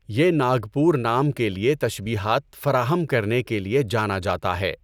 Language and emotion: Urdu, neutral